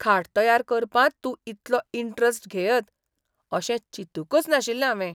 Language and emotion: Goan Konkani, surprised